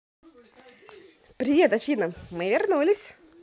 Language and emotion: Russian, positive